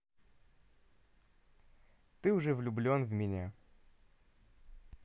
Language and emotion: Russian, positive